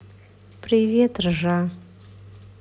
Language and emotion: Russian, sad